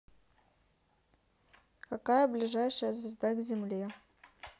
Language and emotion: Russian, neutral